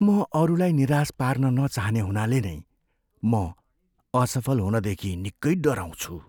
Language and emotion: Nepali, fearful